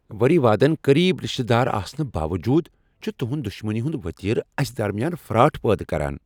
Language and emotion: Kashmiri, angry